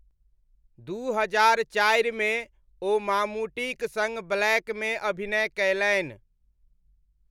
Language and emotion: Maithili, neutral